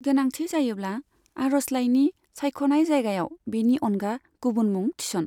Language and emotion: Bodo, neutral